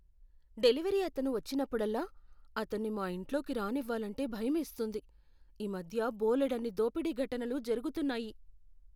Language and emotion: Telugu, fearful